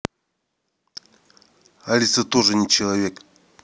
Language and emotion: Russian, neutral